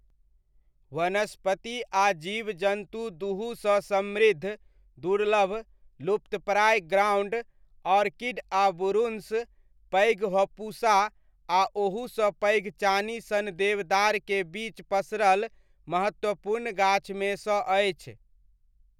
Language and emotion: Maithili, neutral